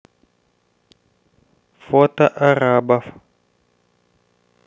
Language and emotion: Russian, neutral